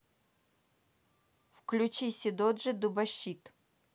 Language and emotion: Russian, neutral